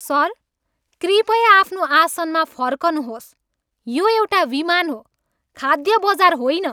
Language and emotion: Nepali, angry